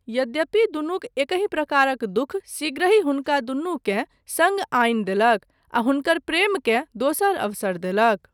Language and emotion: Maithili, neutral